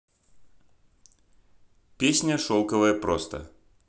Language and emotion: Russian, neutral